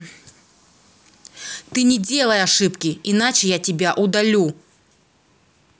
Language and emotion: Russian, angry